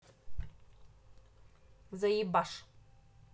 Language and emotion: Russian, angry